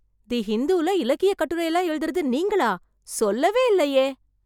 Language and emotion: Tamil, surprised